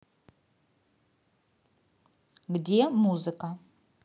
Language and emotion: Russian, neutral